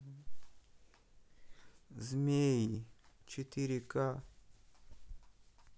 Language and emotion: Russian, sad